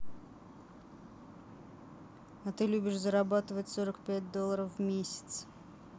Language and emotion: Russian, neutral